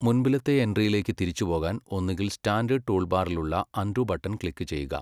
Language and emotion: Malayalam, neutral